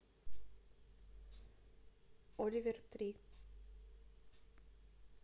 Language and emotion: Russian, neutral